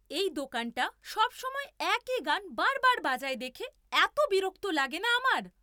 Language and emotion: Bengali, angry